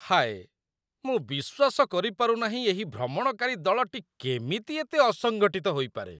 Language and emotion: Odia, disgusted